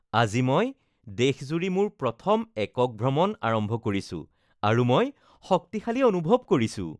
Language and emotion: Assamese, happy